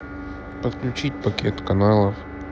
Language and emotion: Russian, neutral